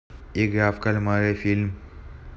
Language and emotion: Russian, neutral